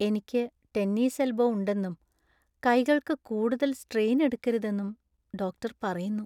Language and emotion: Malayalam, sad